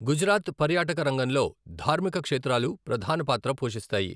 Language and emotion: Telugu, neutral